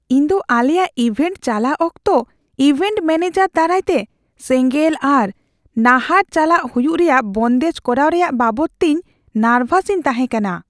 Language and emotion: Santali, fearful